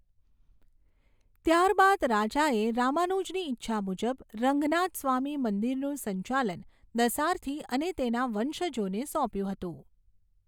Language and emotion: Gujarati, neutral